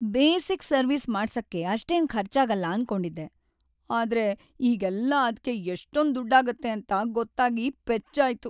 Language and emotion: Kannada, sad